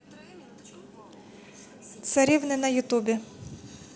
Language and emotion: Russian, neutral